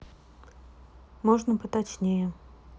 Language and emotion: Russian, neutral